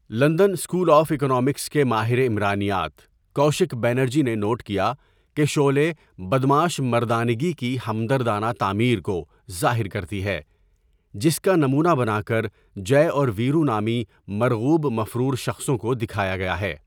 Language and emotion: Urdu, neutral